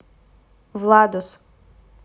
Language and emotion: Russian, neutral